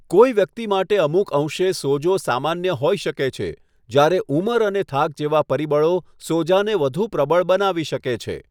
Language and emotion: Gujarati, neutral